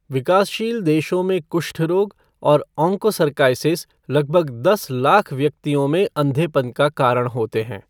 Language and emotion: Hindi, neutral